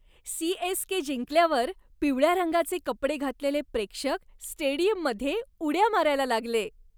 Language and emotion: Marathi, happy